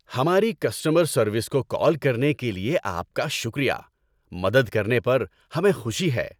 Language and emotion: Urdu, happy